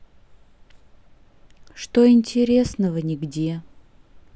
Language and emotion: Russian, neutral